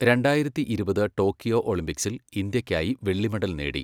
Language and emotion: Malayalam, neutral